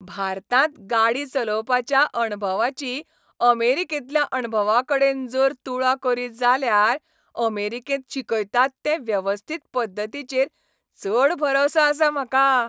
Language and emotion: Goan Konkani, happy